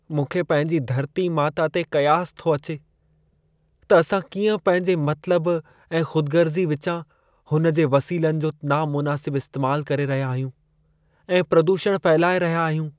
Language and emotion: Sindhi, sad